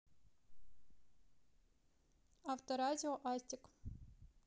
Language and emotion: Russian, neutral